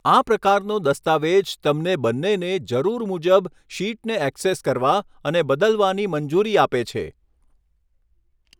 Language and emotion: Gujarati, neutral